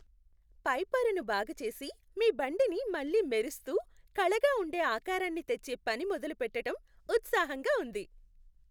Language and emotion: Telugu, happy